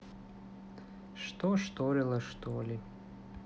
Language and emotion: Russian, sad